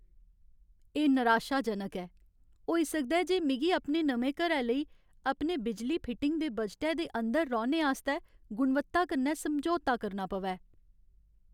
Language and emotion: Dogri, sad